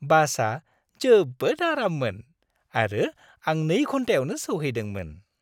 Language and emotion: Bodo, happy